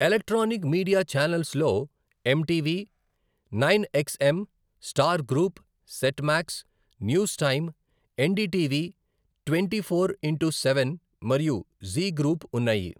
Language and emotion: Telugu, neutral